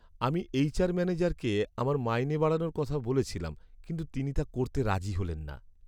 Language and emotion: Bengali, sad